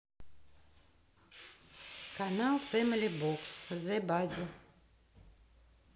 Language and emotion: Russian, neutral